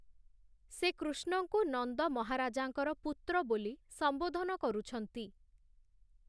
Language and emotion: Odia, neutral